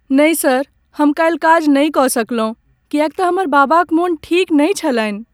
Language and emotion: Maithili, sad